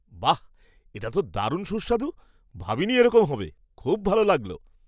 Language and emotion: Bengali, surprised